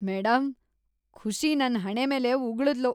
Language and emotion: Kannada, disgusted